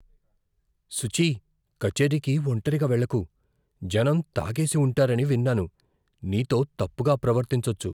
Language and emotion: Telugu, fearful